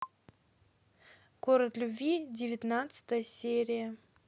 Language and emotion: Russian, neutral